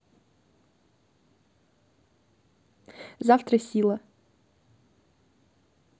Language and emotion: Russian, neutral